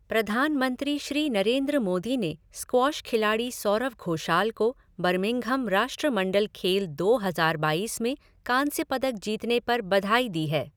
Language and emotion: Hindi, neutral